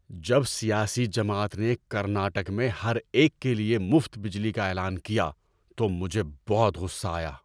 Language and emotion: Urdu, angry